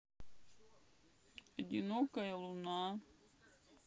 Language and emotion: Russian, sad